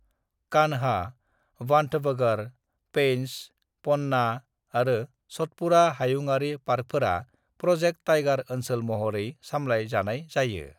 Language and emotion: Bodo, neutral